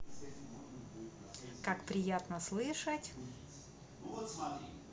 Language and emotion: Russian, positive